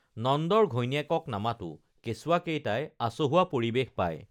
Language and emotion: Assamese, neutral